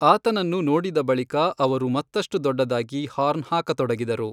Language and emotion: Kannada, neutral